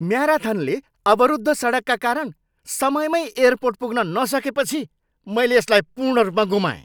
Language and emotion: Nepali, angry